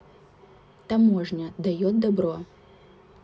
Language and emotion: Russian, neutral